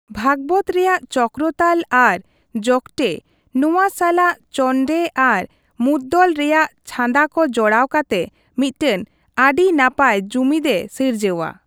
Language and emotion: Santali, neutral